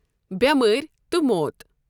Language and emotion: Kashmiri, neutral